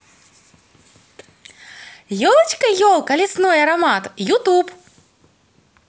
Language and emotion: Russian, positive